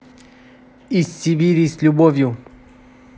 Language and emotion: Russian, positive